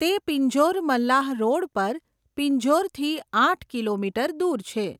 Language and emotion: Gujarati, neutral